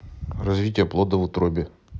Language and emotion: Russian, neutral